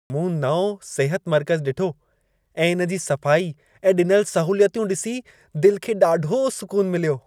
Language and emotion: Sindhi, happy